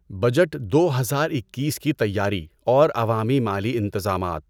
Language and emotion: Urdu, neutral